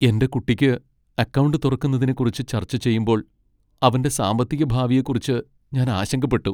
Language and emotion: Malayalam, sad